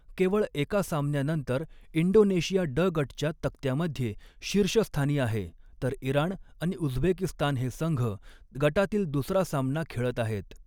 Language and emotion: Marathi, neutral